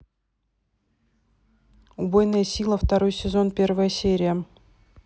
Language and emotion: Russian, neutral